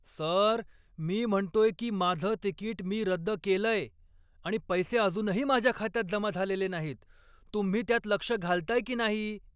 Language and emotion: Marathi, angry